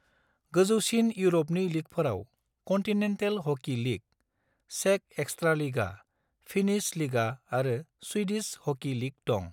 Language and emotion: Bodo, neutral